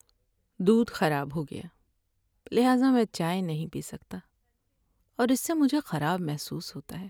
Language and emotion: Urdu, sad